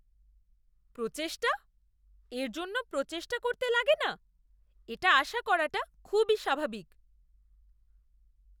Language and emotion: Bengali, disgusted